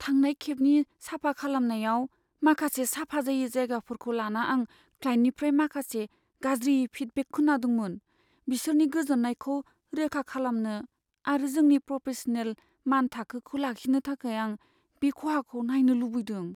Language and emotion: Bodo, fearful